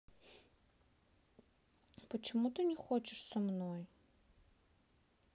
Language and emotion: Russian, sad